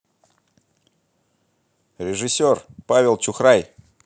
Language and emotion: Russian, positive